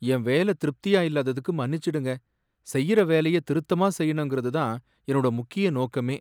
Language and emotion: Tamil, sad